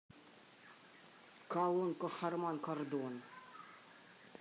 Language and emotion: Russian, neutral